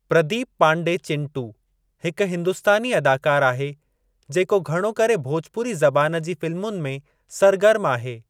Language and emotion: Sindhi, neutral